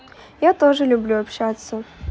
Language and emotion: Russian, positive